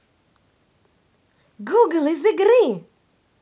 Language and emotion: Russian, positive